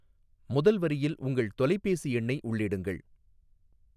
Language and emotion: Tamil, neutral